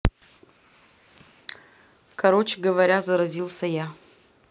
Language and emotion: Russian, neutral